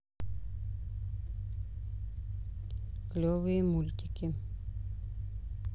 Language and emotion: Russian, neutral